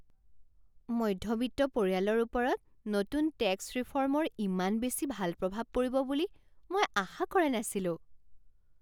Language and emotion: Assamese, surprised